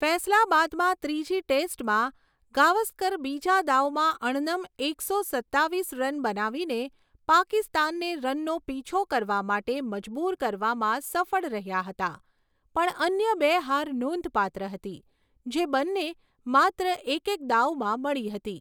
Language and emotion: Gujarati, neutral